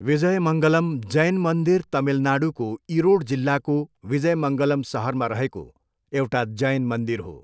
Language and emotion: Nepali, neutral